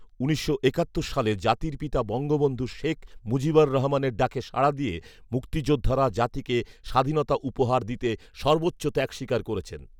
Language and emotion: Bengali, neutral